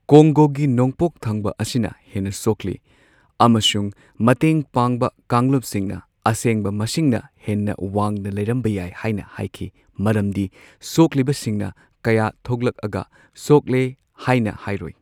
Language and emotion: Manipuri, neutral